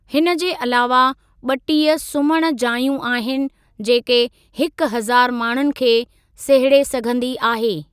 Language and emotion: Sindhi, neutral